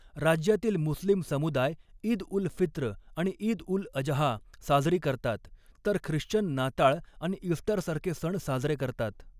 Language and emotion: Marathi, neutral